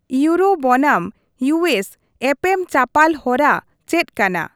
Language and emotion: Santali, neutral